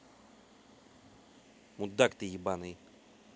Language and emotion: Russian, angry